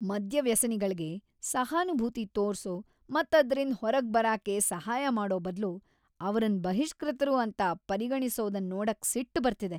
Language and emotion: Kannada, angry